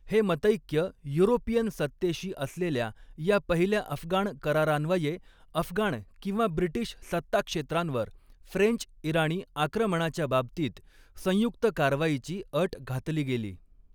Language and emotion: Marathi, neutral